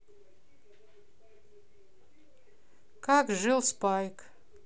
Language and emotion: Russian, neutral